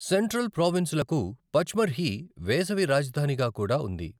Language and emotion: Telugu, neutral